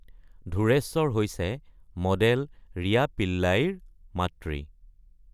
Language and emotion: Assamese, neutral